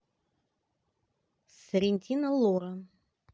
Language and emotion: Russian, neutral